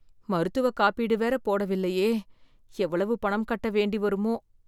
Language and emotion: Tamil, fearful